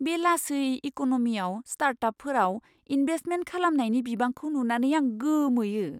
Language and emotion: Bodo, surprised